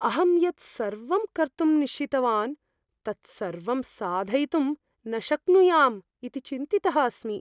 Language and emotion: Sanskrit, fearful